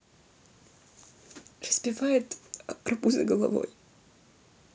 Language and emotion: Russian, sad